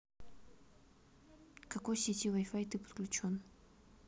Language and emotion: Russian, neutral